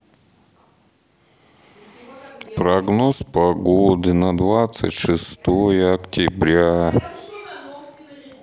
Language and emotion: Russian, sad